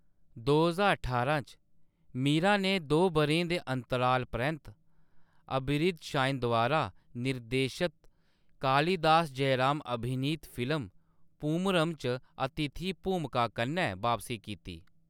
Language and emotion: Dogri, neutral